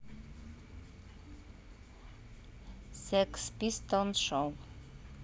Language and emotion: Russian, neutral